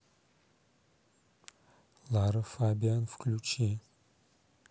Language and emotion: Russian, neutral